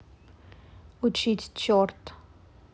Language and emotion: Russian, neutral